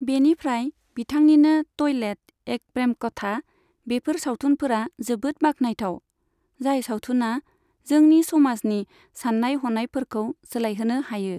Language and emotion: Bodo, neutral